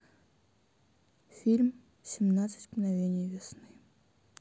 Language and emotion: Russian, neutral